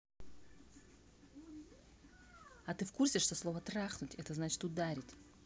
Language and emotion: Russian, angry